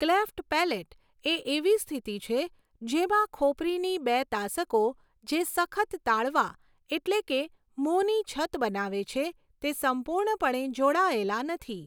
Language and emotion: Gujarati, neutral